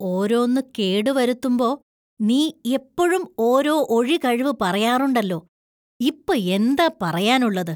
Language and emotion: Malayalam, disgusted